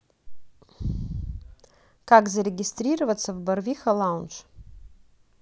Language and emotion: Russian, neutral